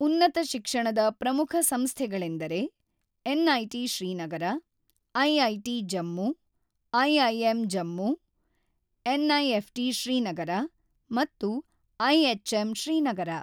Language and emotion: Kannada, neutral